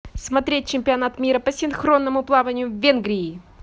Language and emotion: Russian, positive